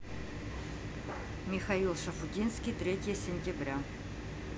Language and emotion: Russian, neutral